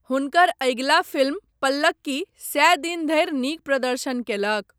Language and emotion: Maithili, neutral